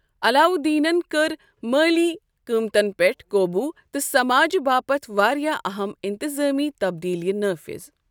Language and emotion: Kashmiri, neutral